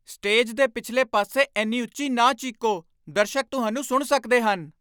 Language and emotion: Punjabi, angry